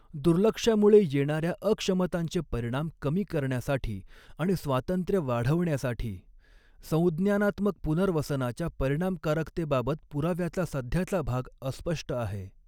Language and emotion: Marathi, neutral